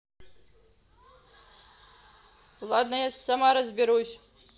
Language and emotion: Russian, angry